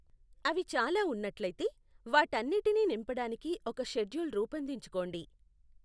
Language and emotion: Telugu, neutral